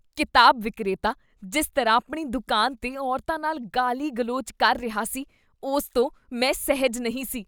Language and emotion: Punjabi, disgusted